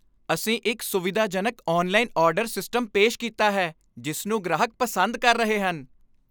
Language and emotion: Punjabi, happy